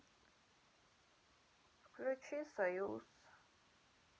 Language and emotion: Russian, sad